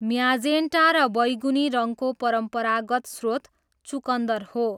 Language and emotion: Nepali, neutral